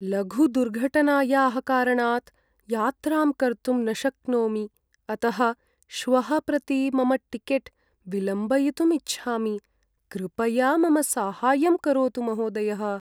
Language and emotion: Sanskrit, sad